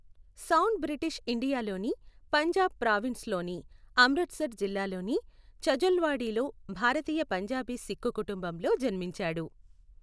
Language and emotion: Telugu, neutral